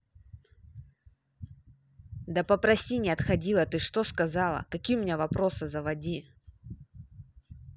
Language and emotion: Russian, angry